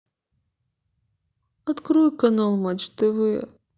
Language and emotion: Russian, sad